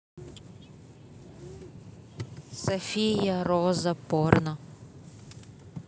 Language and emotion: Russian, neutral